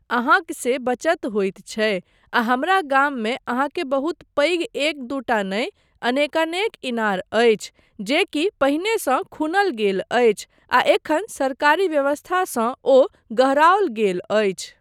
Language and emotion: Maithili, neutral